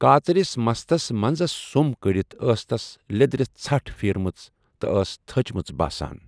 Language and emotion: Kashmiri, neutral